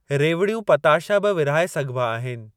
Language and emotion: Sindhi, neutral